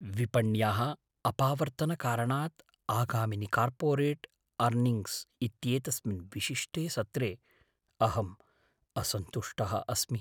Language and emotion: Sanskrit, fearful